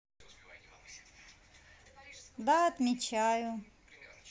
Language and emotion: Russian, positive